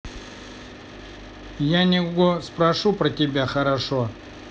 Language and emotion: Russian, neutral